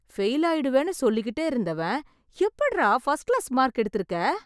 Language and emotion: Tamil, surprised